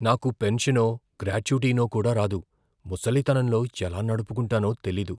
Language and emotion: Telugu, fearful